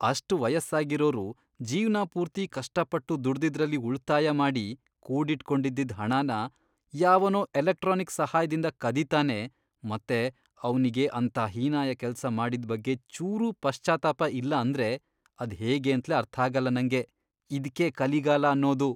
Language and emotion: Kannada, disgusted